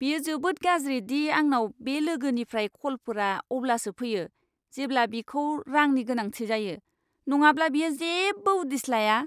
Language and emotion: Bodo, disgusted